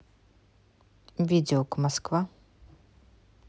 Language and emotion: Russian, neutral